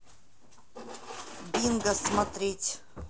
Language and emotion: Russian, neutral